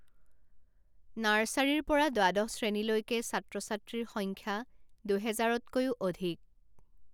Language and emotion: Assamese, neutral